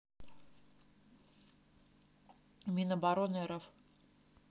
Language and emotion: Russian, neutral